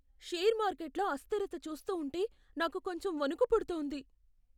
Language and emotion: Telugu, fearful